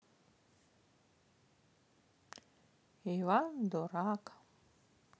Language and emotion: Russian, sad